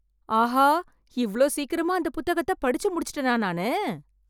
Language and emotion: Tamil, surprised